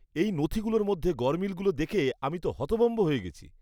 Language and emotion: Bengali, disgusted